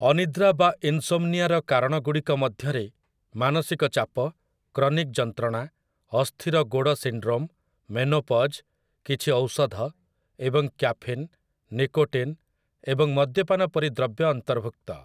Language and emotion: Odia, neutral